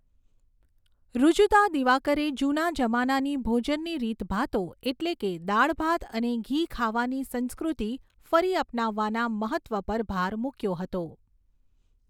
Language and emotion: Gujarati, neutral